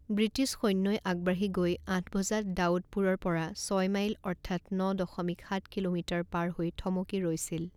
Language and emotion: Assamese, neutral